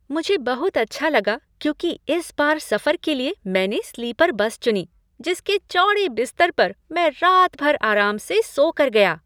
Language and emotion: Hindi, happy